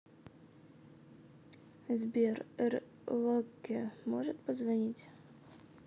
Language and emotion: Russian, neutral